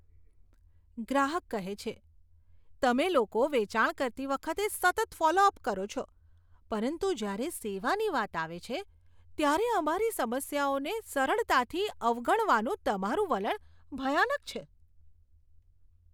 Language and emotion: Gujarati, disgusted